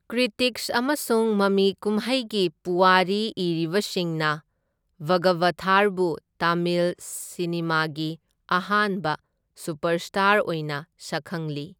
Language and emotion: Manipuri, neutral